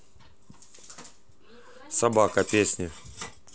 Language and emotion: Russian, neutral